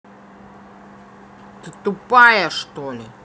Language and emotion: Russian, angry